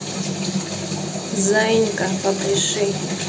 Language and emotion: Russian, neutral